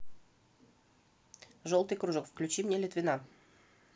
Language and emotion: Russian, neutral